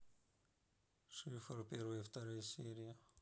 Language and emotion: Russian, neutral